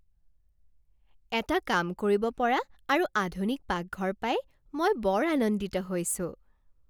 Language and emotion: Assamese, happy